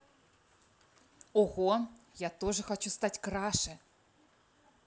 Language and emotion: Russian, positive